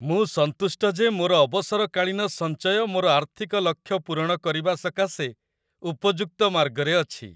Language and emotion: Odia, happy